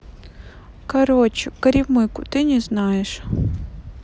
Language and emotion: Russian, sad